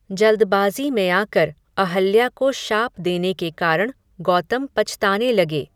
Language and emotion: Hindi, neutral